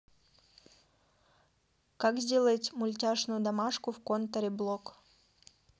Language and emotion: Russian, neutral